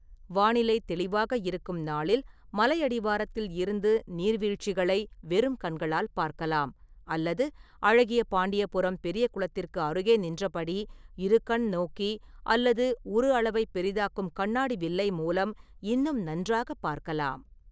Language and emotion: Tamil, neutral